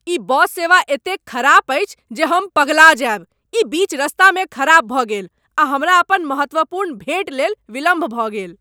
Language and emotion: Maithili, angry